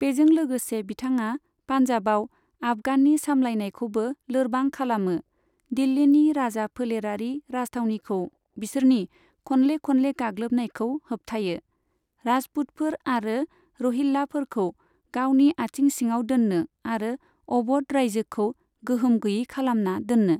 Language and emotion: Bodo, neutral